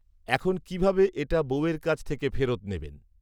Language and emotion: Bengali, neutral